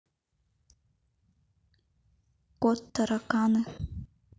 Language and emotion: Russian, neutral